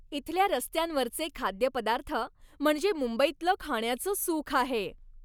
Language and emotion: Marathi, happy